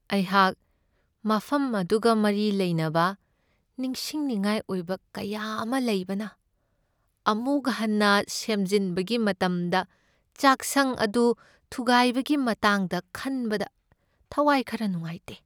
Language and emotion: Manipuri, sad